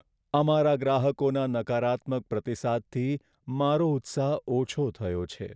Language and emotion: Gujarati, sad